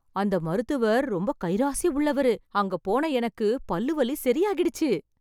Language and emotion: Tamil, happy